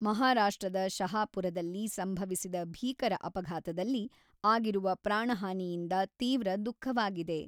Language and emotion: Kannada, neutral